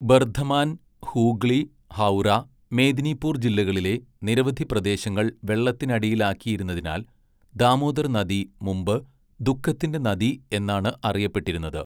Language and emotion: Malayalam, neutral